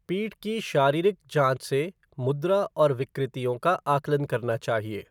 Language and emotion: Hindi, neutral